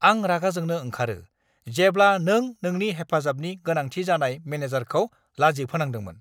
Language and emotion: Bodo, angry